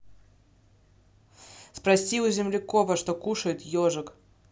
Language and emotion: Russian, neutral